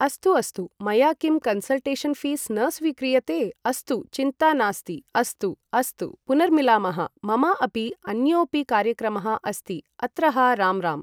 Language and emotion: Sanskrit, neutral